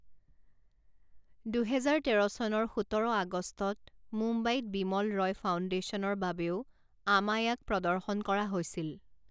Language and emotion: Assamese, neutral